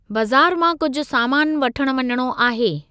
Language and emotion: Sindhi, neutral